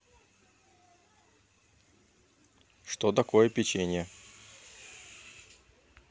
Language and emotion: Russian, neutral